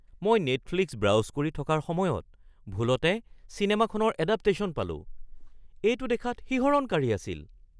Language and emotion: Assamese, surprised